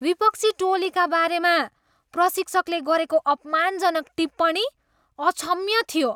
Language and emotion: Nepali, disgusted